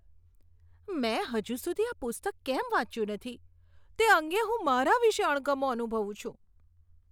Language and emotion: Gujarati, disgusted